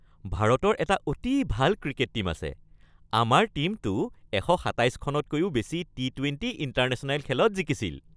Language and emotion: Assamese, happy